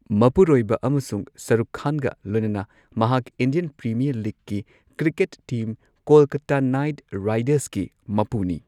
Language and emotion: Manipuri, neutral